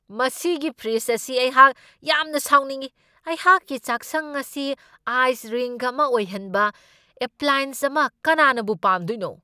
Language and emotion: Manipuri, angry